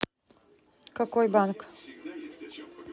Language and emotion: Russian, neutral